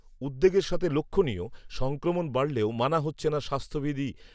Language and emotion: Bengali, neutral